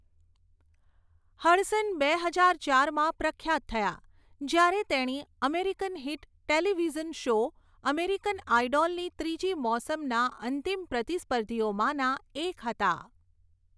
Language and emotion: Gujarati, neutral